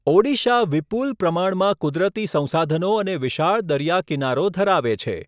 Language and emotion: Gujarati, neutral